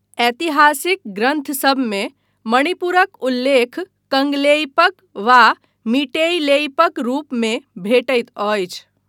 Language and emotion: Maithili, neutral